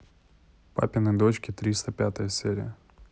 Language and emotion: Russian, neutral